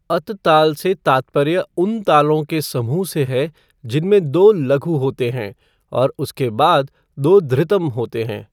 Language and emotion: Hindi, neutral